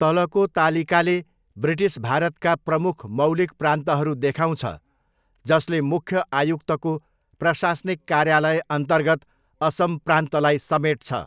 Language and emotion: Nepali, neutral